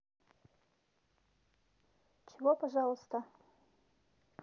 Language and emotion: Russian, neutral